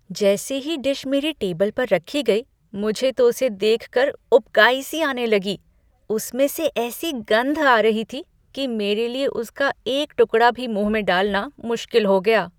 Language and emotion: Hindi, disgusted